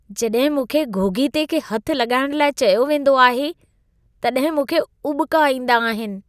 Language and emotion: Sindhi, disgusted